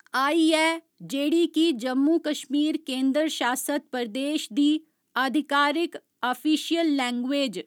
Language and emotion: Dogri, neutral